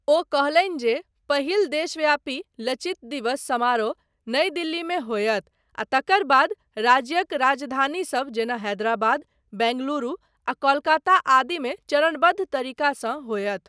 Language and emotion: Maithili, neutral